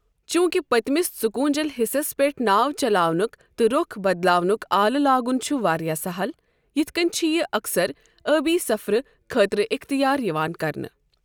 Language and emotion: Kashmiri, neutral